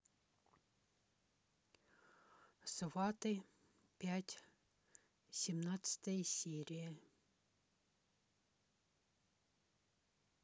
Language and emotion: Russian, neutral